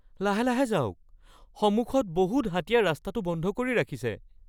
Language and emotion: Assamese, fearful